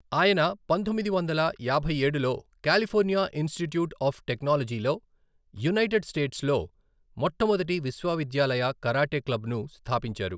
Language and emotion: Telugu, neutral